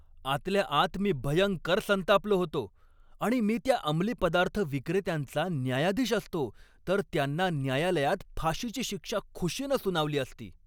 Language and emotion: Marathi, angry